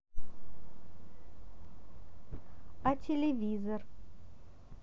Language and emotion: Russian, neutral